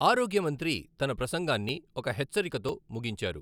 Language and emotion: Telugu, neutral